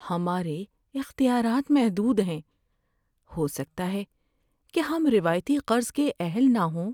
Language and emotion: Urdu, sad